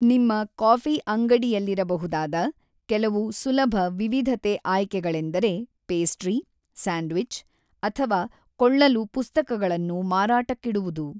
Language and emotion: Kannada, neutral